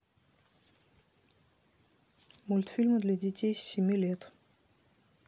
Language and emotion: Russian, neutral